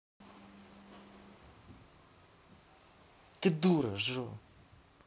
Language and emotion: Russian, angry